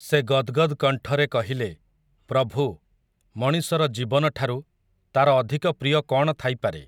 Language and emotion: Odia, neutral